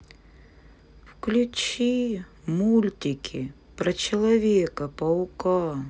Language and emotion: Russian, sad